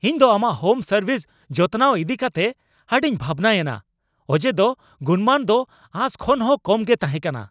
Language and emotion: Santali, angry